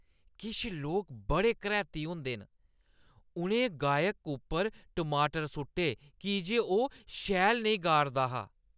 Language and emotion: Dogri, disgusted